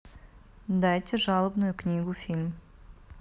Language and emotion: Russian, neutral